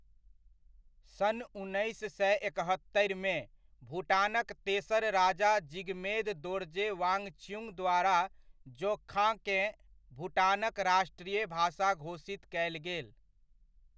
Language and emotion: Maithili, neutral